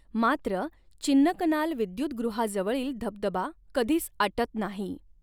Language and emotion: Marathi, neutral